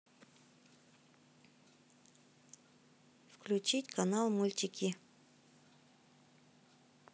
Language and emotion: Russian, neutral